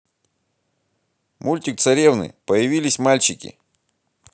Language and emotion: Russian, positive